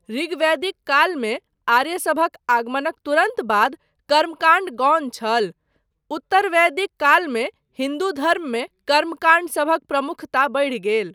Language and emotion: Maithili, neutral